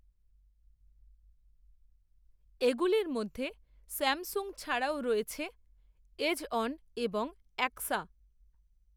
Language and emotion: Bengali, neutral